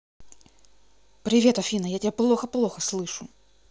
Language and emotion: Russian, neutral